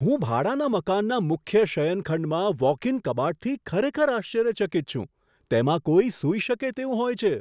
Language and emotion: Gujarati, surprised